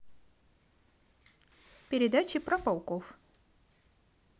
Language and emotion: Russian, positive